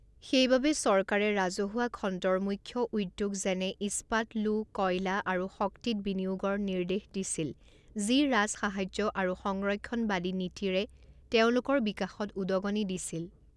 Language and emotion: Assamese, neutral